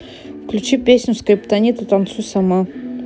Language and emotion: Russian, neutral